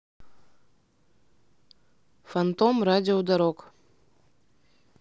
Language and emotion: Russian, neutral